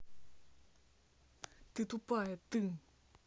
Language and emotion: Russian, angry